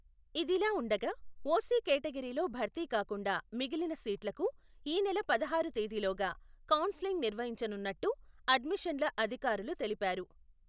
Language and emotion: Telugu, neutral